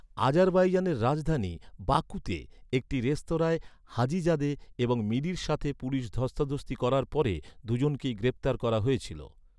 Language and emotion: Bengali, neutral